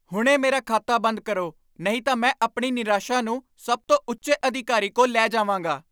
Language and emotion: Punjabi, angry